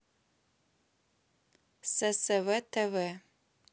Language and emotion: Russian, neutral